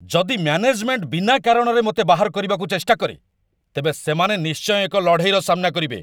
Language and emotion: Odia, angry